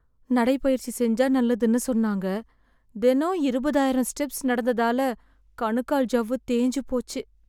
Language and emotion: Tamil, sad